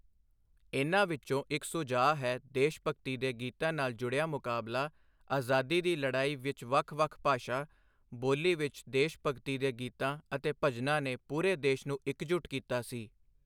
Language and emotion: Punjabi, neutral